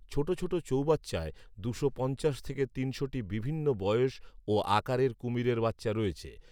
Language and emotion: Bengali, neutral